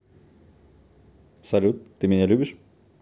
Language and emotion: Russian, neutral